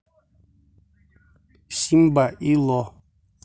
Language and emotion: Russian, neutral